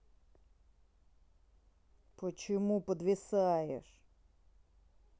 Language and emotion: Russian, angry